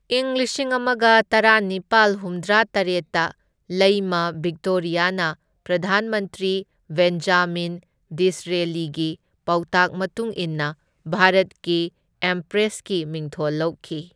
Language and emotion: Manipuri, neutral